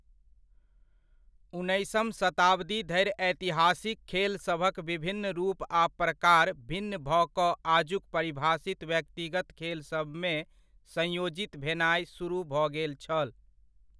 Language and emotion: Maithili, neutral